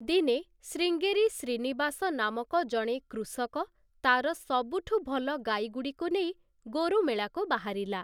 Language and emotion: Odia, neutral